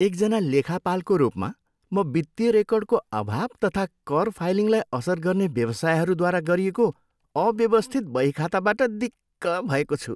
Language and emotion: Nepali, disgusted